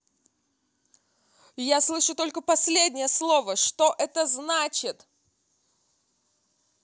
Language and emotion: Russian, angry